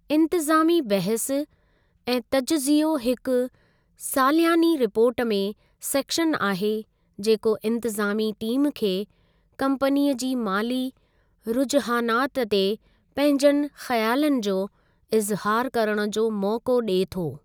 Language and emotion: Sindhi, neutral